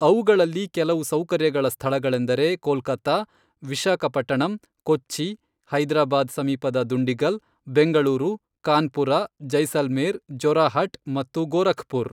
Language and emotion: Kannada, neutral